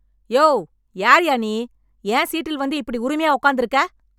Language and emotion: Tamil, angry